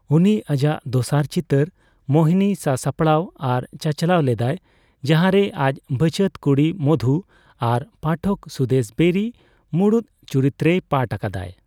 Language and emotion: Santali, neutral